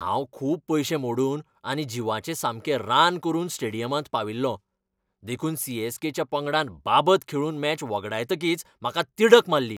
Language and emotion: Goan Konkani, angry